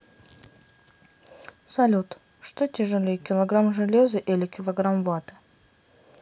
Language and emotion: Russian, neutral